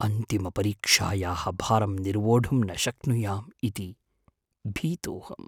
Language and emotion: Sanskrit, fearful